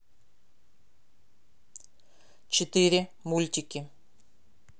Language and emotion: Russian, neutral